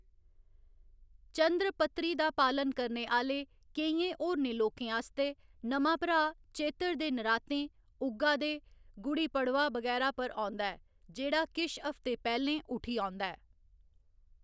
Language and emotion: Dogri, neutral